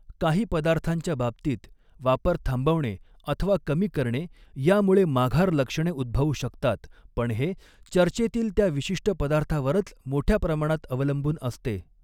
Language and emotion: Marathi, neutral